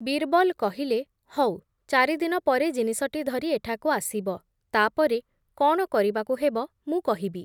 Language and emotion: Odia, neutral